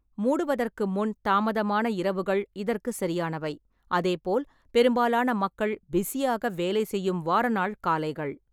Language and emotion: Tamil, neutral